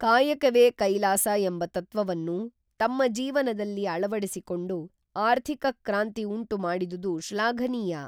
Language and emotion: Kannada, neutral